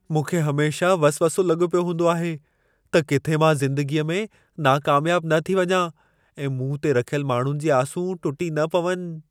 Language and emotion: Sindhi, fearful